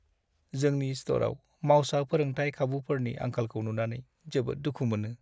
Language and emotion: Bodo, sad